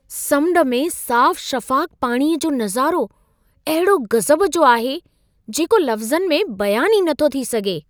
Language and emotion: Sindhi, surprised